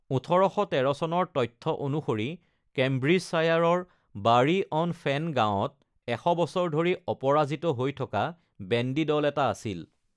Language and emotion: Assamese, neutral